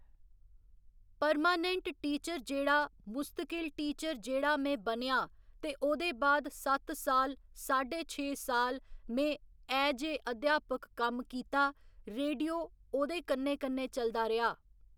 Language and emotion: Dogri, neutral